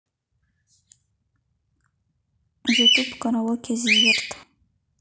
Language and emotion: Russian, neutral